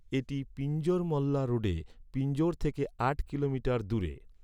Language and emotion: Bengali, neutral